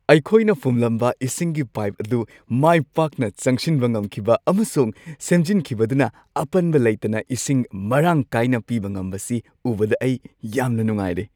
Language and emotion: Manipuri, happy